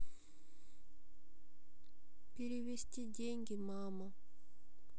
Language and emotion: Russian, sad